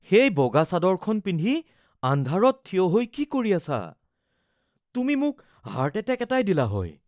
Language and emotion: Assamese, fearful